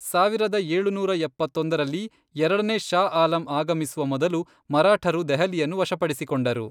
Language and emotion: Kannada, neutral